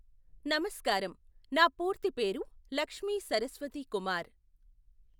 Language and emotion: Telugu, neutral